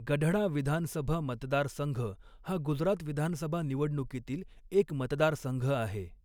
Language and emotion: Marathi, neutral